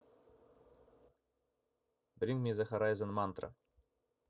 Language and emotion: Russian, neutral